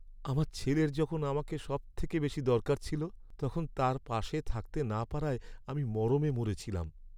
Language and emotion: Bengali, sad